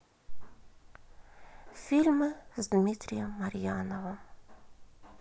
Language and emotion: Russian, sad